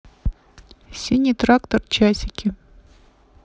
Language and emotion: Russian, neutral